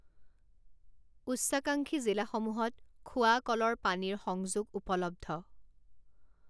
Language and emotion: Assamese, neutral